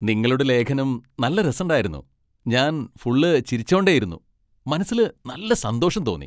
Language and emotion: Malayalam, happy